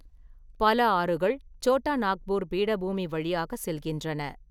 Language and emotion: Tamil, neutral